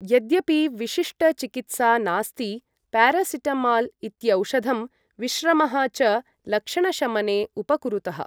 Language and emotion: Sanskrit, neutral